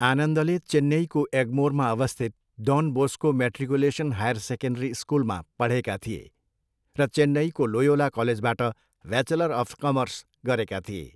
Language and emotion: Nepali, neutral